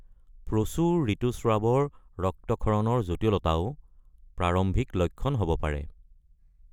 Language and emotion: Assamese, neutral